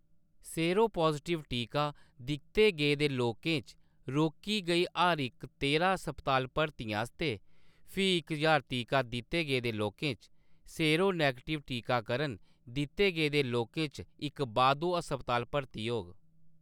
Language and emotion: Dogri, neutral